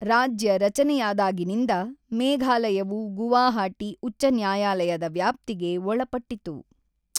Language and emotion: Kannada, neutral